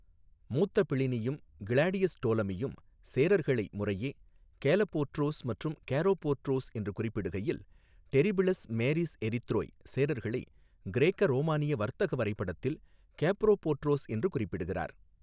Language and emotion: Tamil, neutral